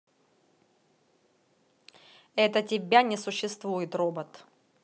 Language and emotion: Russian, angry